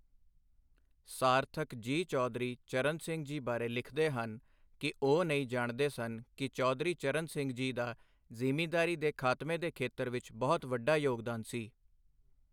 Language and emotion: Punjabi, neutral